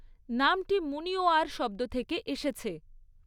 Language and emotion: Bengali, neutral